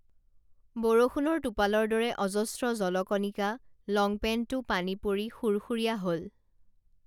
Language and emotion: Assamese, neutral